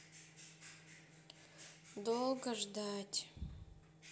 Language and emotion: Russian, sad